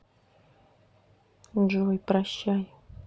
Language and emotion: Russian, sad